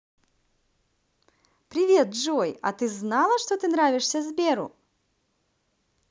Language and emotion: Russian, positive